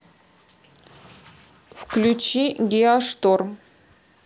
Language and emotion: Russian, neutral